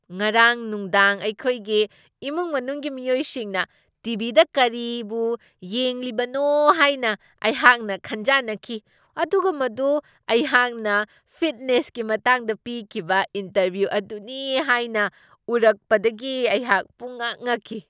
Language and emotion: Manipuri, surprised